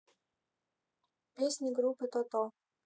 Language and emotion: Russian, neutral